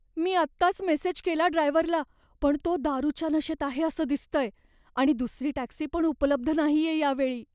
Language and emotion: Marathi, fearful